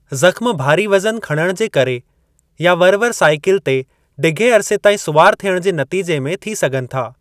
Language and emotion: Sindhi, neutral